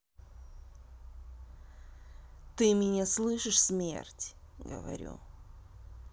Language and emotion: Russian, angry